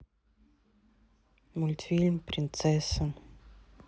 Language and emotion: Russian, neutral